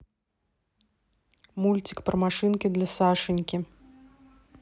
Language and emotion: Russian, neutral